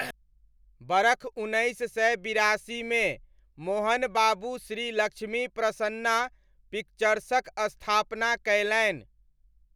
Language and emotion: Maithili, neutral